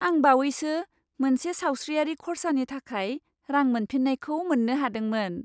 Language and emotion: Bodo, happy